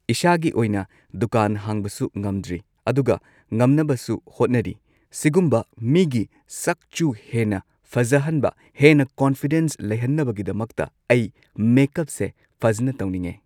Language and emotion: Manipuri, neutral